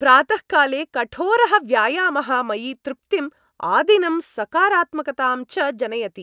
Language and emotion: Sanskrit, happy